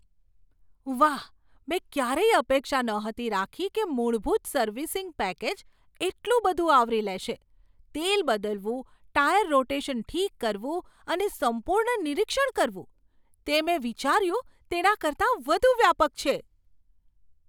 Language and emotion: Gujarati, surprised